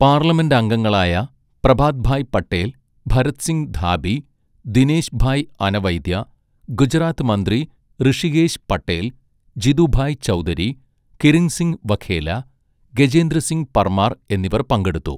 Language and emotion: Malayalam, neutral